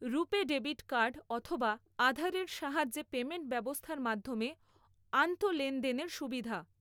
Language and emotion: Bengali, neutral